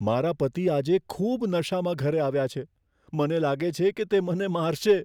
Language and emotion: Gujarati, fearful